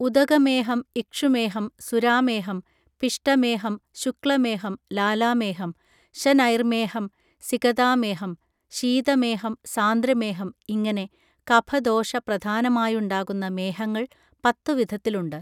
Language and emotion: Malayalam, neutral